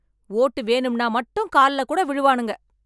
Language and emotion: Tamil, angry